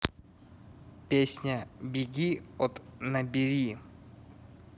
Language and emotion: Russian, neutral